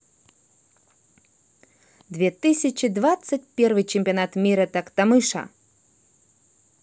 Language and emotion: Russian, positive